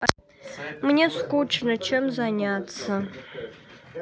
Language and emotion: Russian, sad